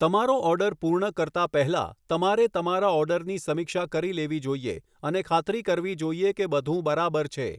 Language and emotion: Gujarati, neutral